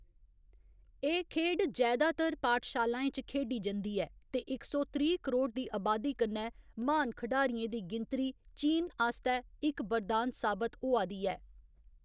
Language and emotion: Dogri, neutral